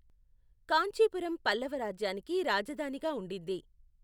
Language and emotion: Telugu, neutral